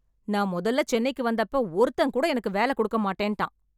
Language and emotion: Tamil, angry